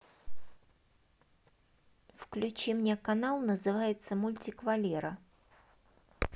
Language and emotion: Russian, neutral